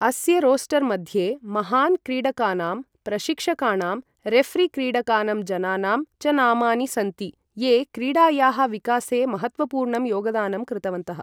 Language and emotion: Sanskrit, neutral